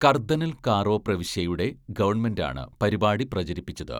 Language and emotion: Malayalam, neutral